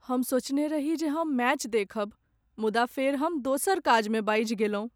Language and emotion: Maithili, sad